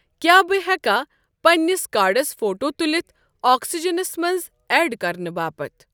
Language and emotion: Kashmiri, neutral